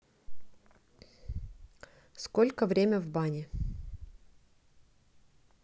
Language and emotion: Russian, neutral